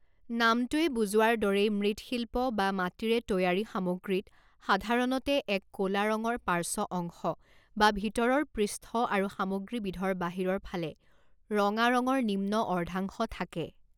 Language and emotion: Assamese, neutral